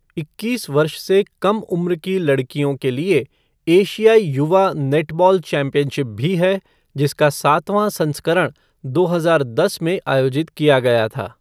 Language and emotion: Hindi, neutral